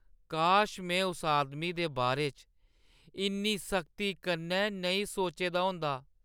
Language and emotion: Dogri, sad